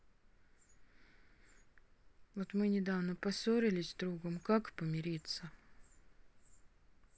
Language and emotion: Russian, sad